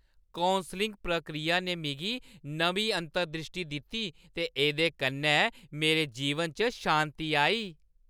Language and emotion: Dogri, happy